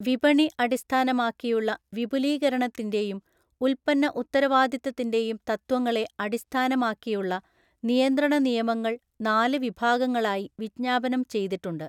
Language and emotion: Malayalam, neutral